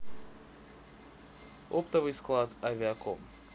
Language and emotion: Russian, neutral